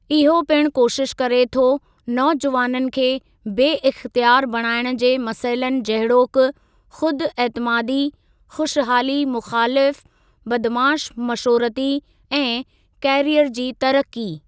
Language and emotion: Sindhi, neutral